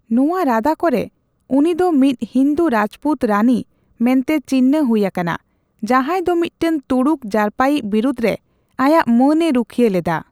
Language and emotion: Santali, neutral